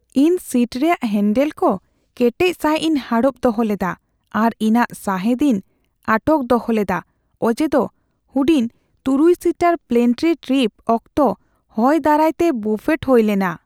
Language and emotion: Santali, fearful